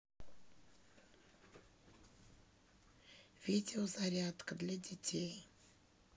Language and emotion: Russian, neutral